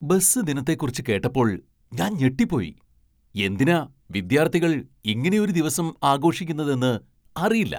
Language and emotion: Malayalam, surprised